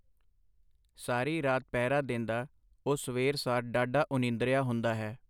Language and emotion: Punjabi, neutral